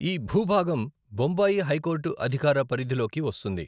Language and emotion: Telugu, neutral